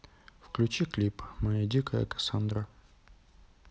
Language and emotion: Russian, neutral